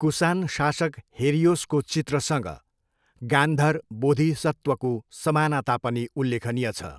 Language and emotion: Nepali, neutral